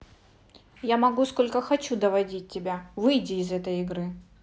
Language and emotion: Russian, angry